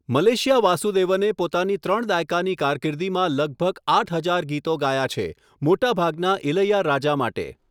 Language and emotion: Gujarati, neutral